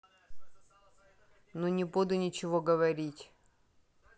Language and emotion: Russian, neutral